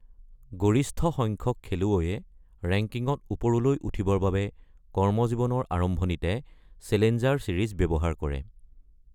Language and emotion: Assamese, neutral